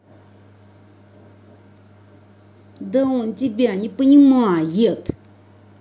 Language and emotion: Russian, angry